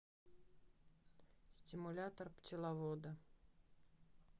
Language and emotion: Russian, neutral